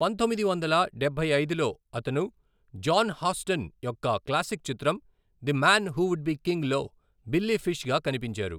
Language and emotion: Telugu, neutral